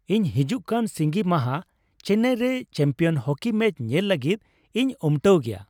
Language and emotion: Santali, happy